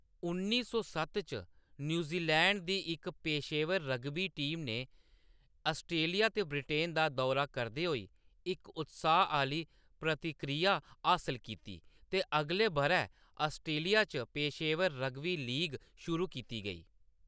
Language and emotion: Dogri, neutral